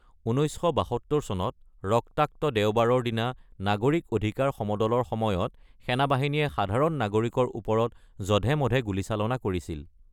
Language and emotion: Assamese, neutral